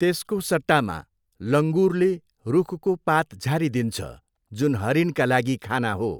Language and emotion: Nepali, neutral